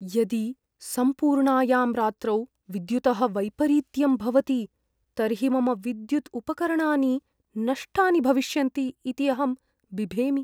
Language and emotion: Sanskrit, fearful